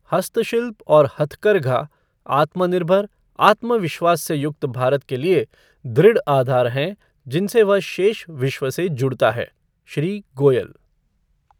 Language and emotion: Hindi, neutral